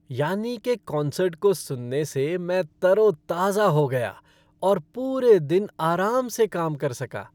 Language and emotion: Hindi, happy